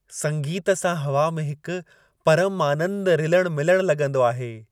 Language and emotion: Sindhi, happy